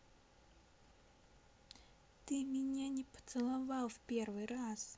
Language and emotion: Russian, sad